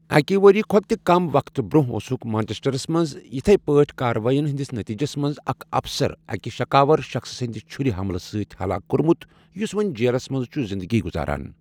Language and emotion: Kashmiri, neutral